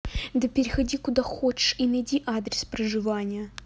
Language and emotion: Russian, angry